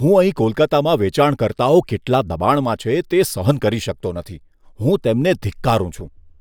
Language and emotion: Gujarati, disgusted